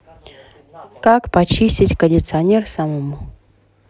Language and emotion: Russian, neutral